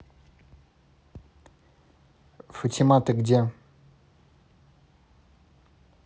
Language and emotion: Russian, neutral